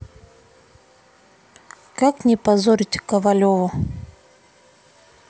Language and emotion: Russian, neutral